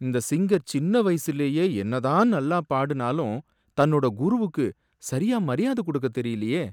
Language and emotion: Tamil, sad